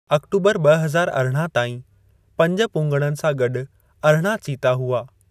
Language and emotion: Sindhi, neutral